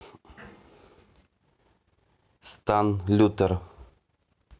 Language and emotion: Russian, neutral